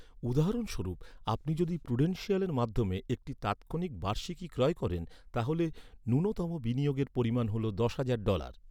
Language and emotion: Bengali, neutral